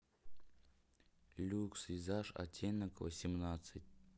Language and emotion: Russian, neutral